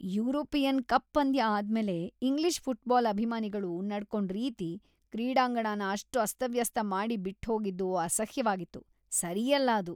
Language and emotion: Kannada, disgusted